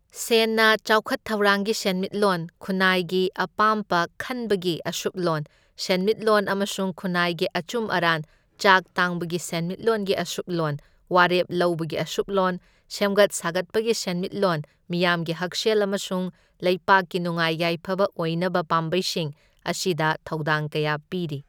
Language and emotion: Manipuri, neutral